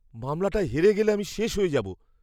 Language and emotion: Bengali, fearful